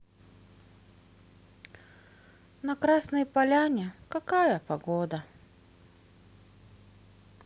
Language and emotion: Russian, sad